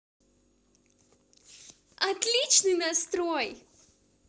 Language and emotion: Russian, positive